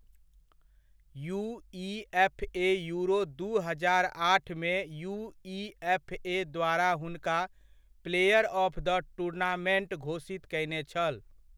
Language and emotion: Maithili, neutral